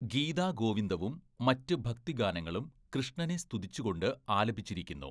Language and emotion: Malayalam, neutral